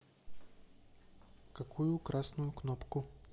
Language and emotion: Russian, neutral